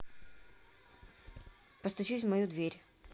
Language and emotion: Russian, neutral